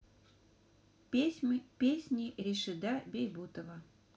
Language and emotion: Russian, neutral